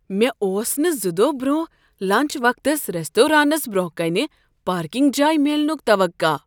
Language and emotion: Kashmiri, surprised